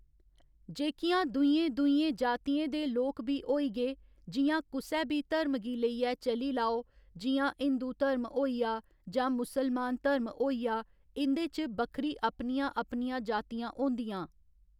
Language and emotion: Dogri, neutral